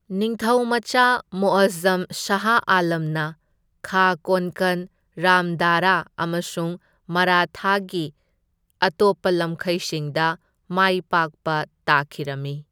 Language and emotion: Manipuri, neutral